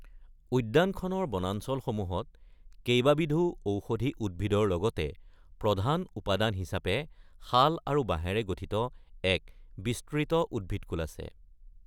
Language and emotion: Assamese, neutral